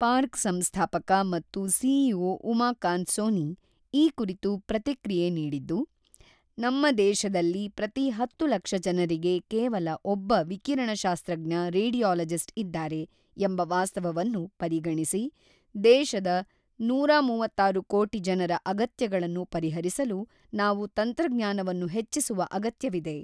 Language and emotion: Kannada, neutral